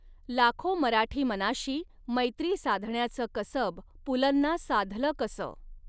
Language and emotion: Marathi, neutral